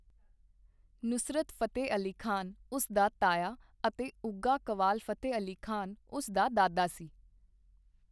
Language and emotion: Punjabi, neutral